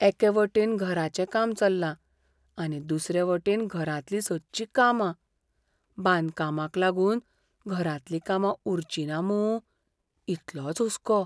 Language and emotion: Goan Konkani, fearful